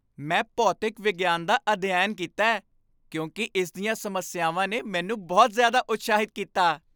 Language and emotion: Punjabi, happy